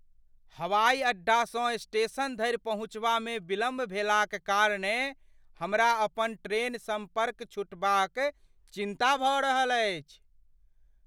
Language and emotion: Maithili, fearful